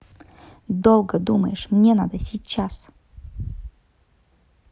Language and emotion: Russian, angry